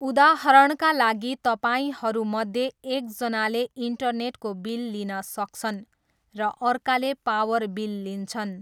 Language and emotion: Nepali, neutral